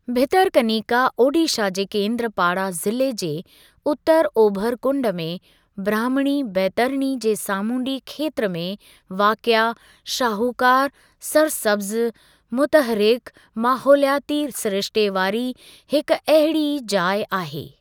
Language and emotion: Sindhi, neutral